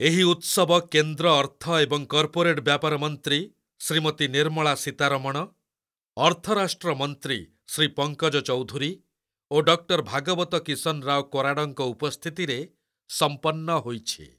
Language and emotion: Odia, neutral